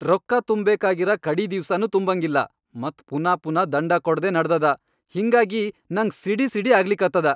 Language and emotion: Kannada, angry